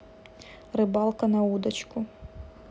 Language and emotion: Russian, neutral